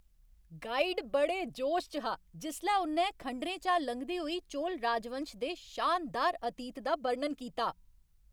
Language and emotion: Dogri, happy